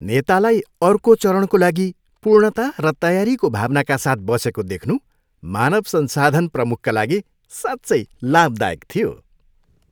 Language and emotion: Nepali, happy